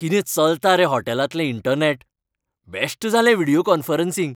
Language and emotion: Goan Konkani, happy